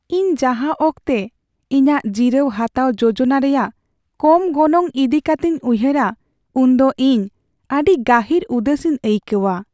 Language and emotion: Santali, sad